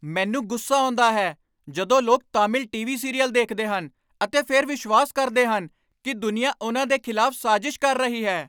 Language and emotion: Punjabi, angry